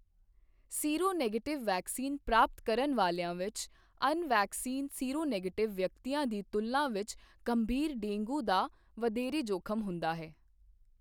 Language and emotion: Punjabi, neutral